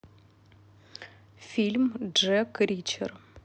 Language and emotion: Russian, neutral